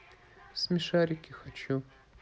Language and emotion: Russian, neutral